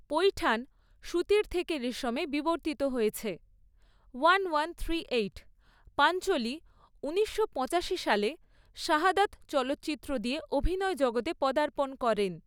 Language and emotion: Bengali, neutral